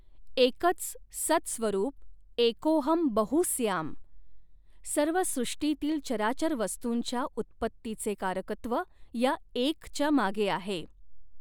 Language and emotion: Marathi, neutral